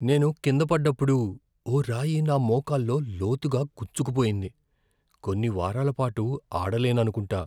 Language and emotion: Telugu, fearful